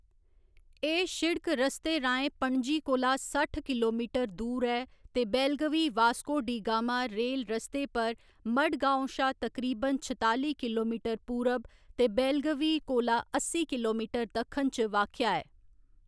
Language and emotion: Dogri, neutral